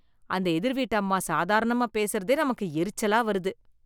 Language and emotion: Tamil, disgusted